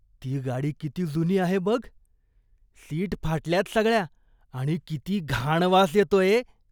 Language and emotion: Marathi, disgusted